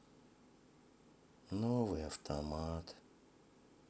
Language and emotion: Russian, sad